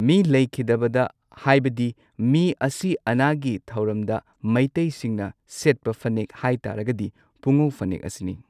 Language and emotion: Manipuri, neutral